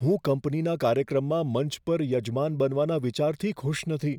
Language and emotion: Gujarati, fearful